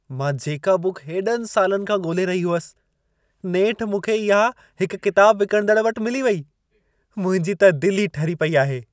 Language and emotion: Sindhi, happy